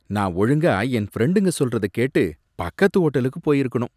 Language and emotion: Tamil, disgusted